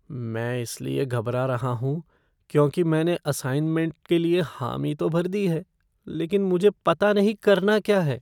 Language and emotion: Hindi, fearful